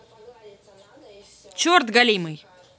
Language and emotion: Russian, angry